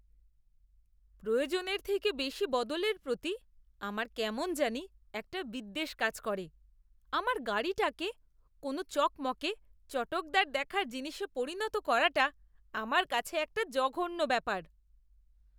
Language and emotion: Bengali, disgusted